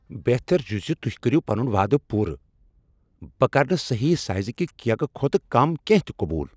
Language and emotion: Kashmiri, angry